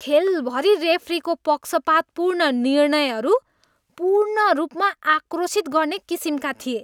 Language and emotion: Nepali, disgusted